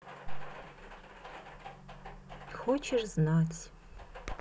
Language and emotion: Russian, sad